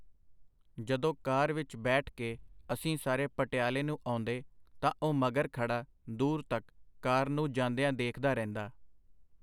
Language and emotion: Punjabi, neutral